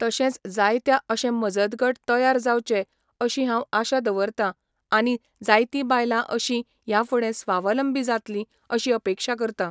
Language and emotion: Goan Konkani, neutral